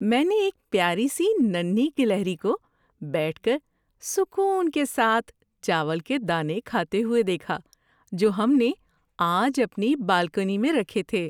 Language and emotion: Urdu, happy